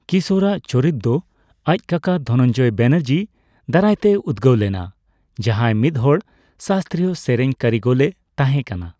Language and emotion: Santali, neutral